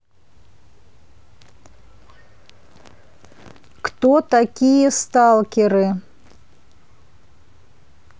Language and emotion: Russian, neutral